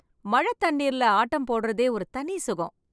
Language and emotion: Tamil, happy